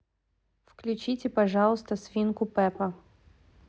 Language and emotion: Russian, neutral